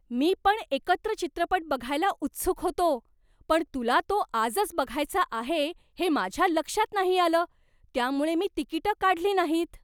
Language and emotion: Marathi, surprised